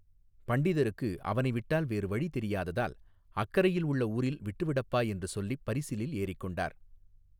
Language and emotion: Tamil, neutral